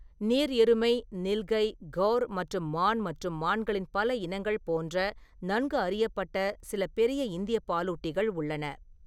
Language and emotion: Tamil, neutral